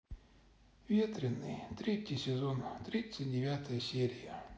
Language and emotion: Russian, sad